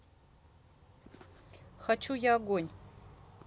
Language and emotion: Russian, neutral